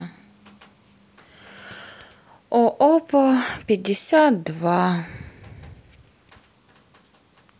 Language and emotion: Russian, sad